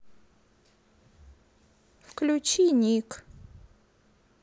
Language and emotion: Russian, sad